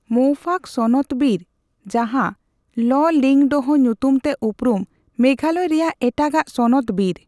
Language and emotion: Santali, neutral